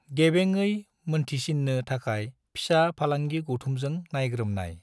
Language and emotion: Bodo, neutral